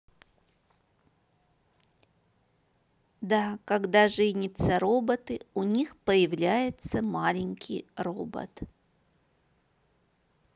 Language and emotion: Russian, neutral